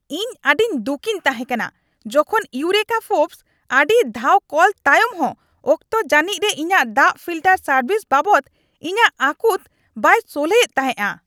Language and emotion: Santali, angry